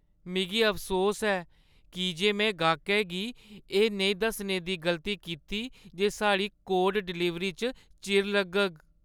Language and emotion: Dogri, sad